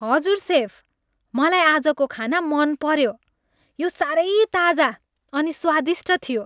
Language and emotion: Nepali, happy